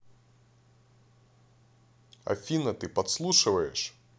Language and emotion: Russian, angry